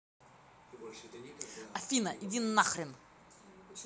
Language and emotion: Russian, angry